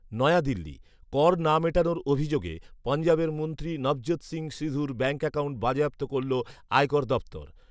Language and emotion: Bengali, neutral